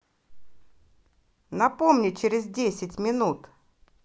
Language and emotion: Russian, positive